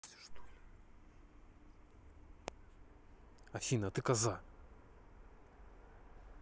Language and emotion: Russian, angry